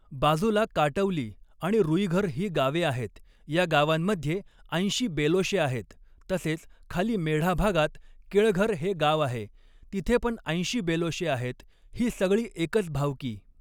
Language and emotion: Marathi, neutral